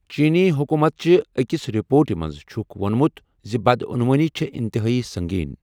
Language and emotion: Kashmiri, neutral